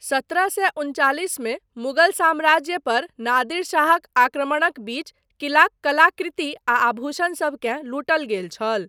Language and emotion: Maithili, neutral